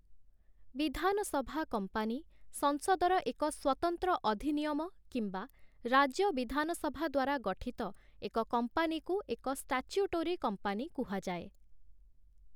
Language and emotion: Odia, neutral